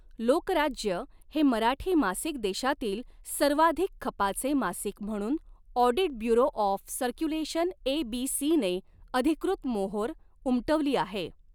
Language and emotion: Marathi, neutral